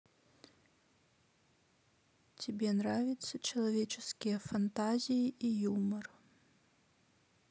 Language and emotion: Russian, sad